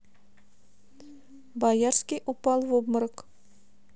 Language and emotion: Russian, neutral